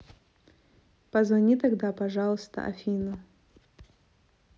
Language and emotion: Russian, neutral